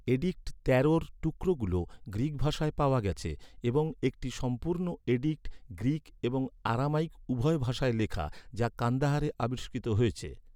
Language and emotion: Bengali, neutral